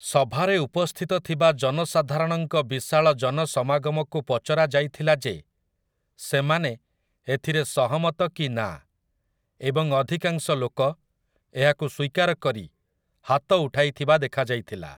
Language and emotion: Odia, neutral